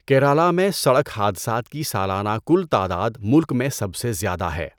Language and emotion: Urdu, neutral